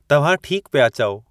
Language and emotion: Sindhi, neutral